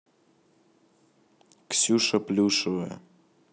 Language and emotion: Russian, neutral